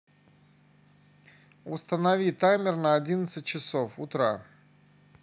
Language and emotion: Russian, neutral